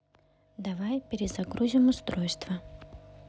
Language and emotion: Russian, neutral